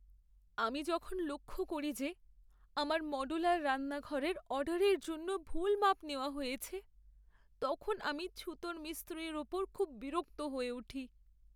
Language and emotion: Bengali, sad